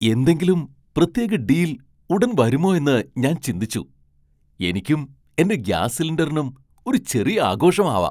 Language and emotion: Malayalam, surprised